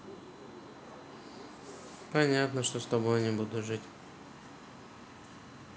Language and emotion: Russian, neutral